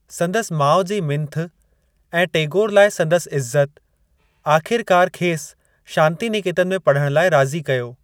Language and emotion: Sindhi, neutral